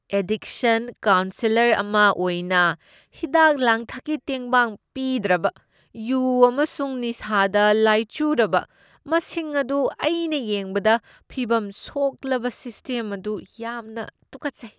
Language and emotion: Manipuri, disgusted